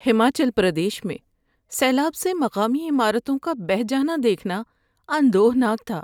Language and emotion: Urdu, sad